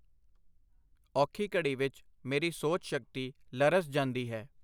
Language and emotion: Punjabi, neutral